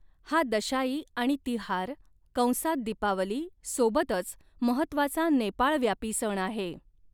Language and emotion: Marathi, neutral